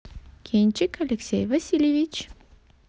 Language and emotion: Russian, positive